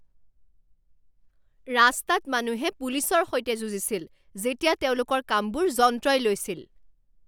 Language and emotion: Assamese, angry